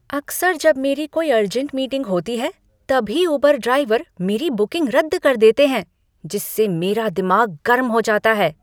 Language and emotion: Hindi, angry